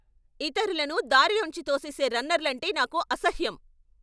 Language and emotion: Telugu, angry